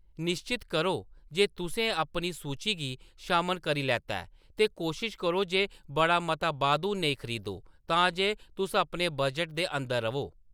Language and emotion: Dogri, neutral